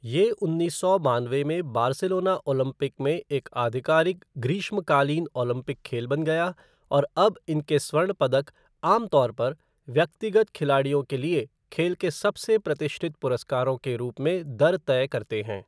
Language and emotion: Hindi, neutral